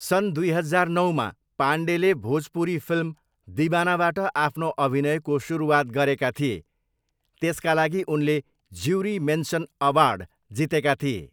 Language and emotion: Nepali, neutral